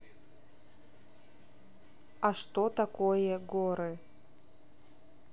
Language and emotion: Russian, neutral